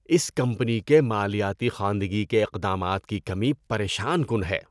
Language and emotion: Urdu, disgusted